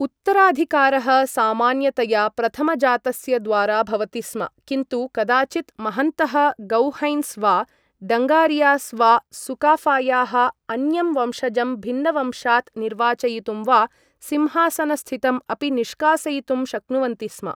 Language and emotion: Sanskrit, neutral